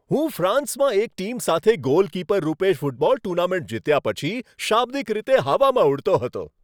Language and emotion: Gujarati, happy